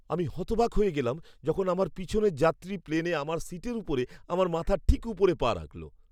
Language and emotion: Bengali, surprised